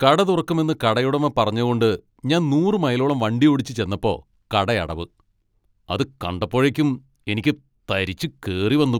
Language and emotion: Malayalam, angry